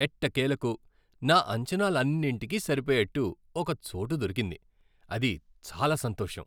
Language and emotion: Telugu, happy